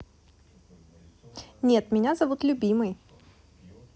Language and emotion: Russian, positive